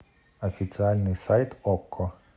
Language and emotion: Russian, neutral